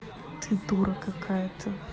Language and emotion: Russian, neutral